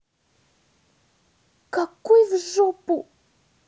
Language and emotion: Russian, angry